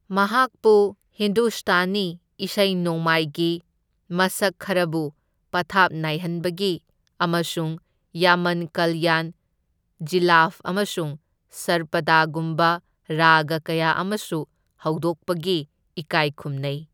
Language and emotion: Manipuri, neutral